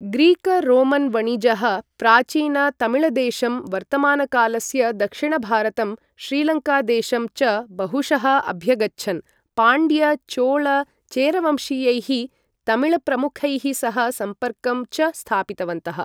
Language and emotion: Sanskrit, neutral